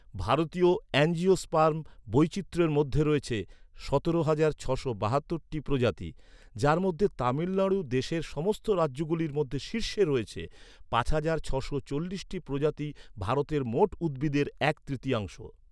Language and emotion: Bengali, neutral